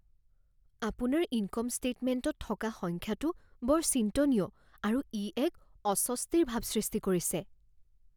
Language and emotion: Assamese, fearful